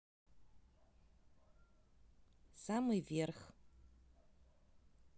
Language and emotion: Russian, neutral